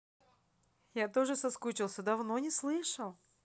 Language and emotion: Russian, positive